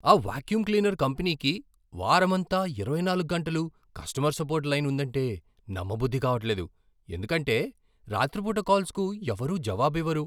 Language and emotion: Telugu, surprised